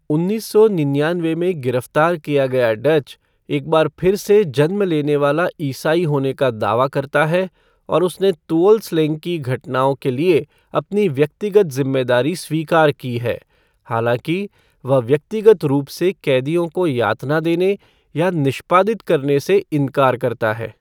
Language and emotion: Hindi, neutral